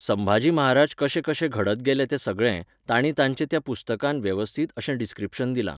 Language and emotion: Goan Konkani, neutral